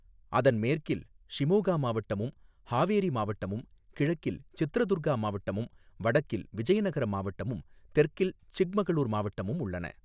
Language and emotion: Tamil, neutral